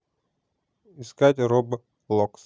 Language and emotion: Russian, neutral